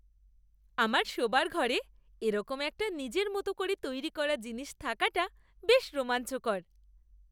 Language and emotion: Bengali, happy